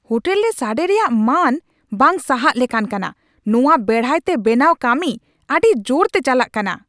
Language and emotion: Santali, angry